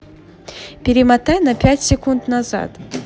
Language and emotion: Russian, positive